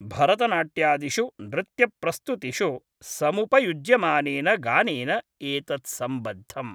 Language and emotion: Sanskrit, neutral